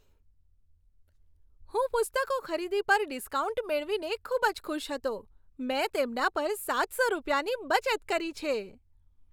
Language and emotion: Gujarati, happy